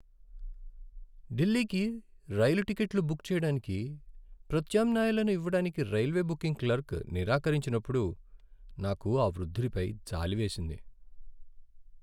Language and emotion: Telugu, sad